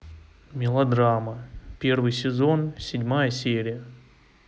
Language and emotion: Russian, neutral